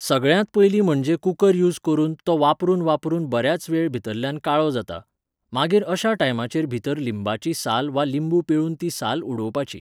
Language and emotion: Goan Konkani, neutral